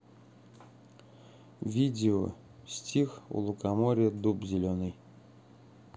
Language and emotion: Russian, neutral